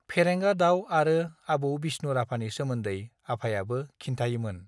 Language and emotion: Bodo, neutral